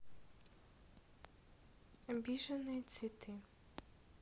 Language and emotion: Russian, neutral